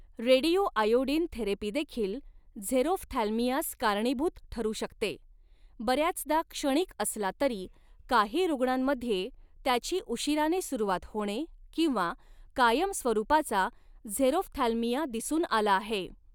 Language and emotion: Marathi, neutral